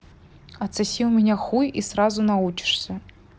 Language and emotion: Russian, neutral